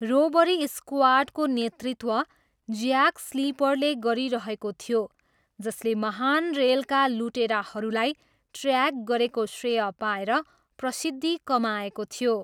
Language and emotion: Nepali, neutral